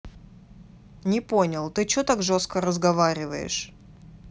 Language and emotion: Russian, neutral